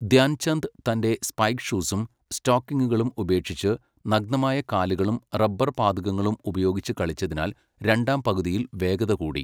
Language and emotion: Malayalam, neutral